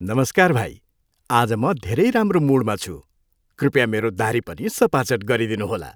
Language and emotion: Nepali, happy